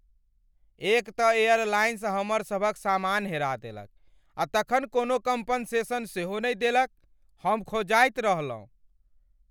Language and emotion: Maithili, angry